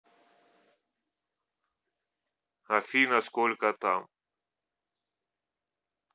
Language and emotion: Russian, neutral